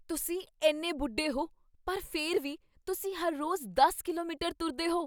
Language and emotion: Punjabi, surprised